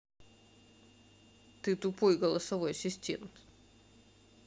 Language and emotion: Russian, neutral